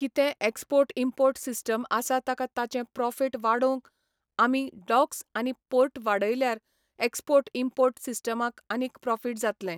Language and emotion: Goan Konkani, neutral